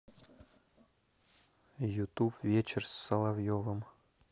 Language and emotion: Russian, neutral